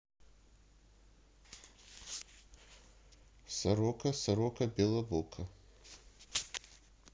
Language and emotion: Russian, neutral